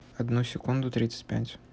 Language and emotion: Russian, neutral